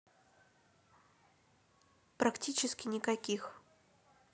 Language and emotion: Russian, neutral